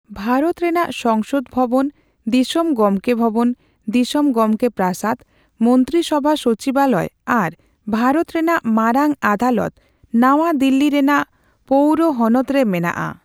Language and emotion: Santali, neutral